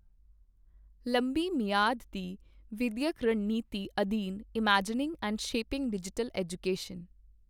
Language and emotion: Punjabi, neutral